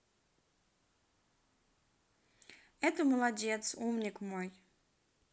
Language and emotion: Russian, neutral